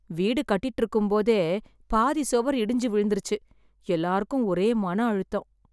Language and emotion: Tamil, sad